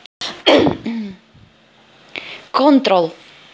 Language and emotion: Russian, neutral